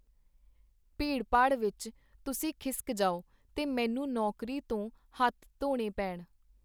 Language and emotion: Punjabi, neutral